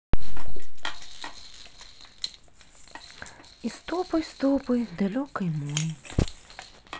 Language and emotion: Russian, sad